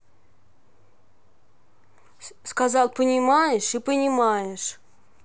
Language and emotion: Russian, angry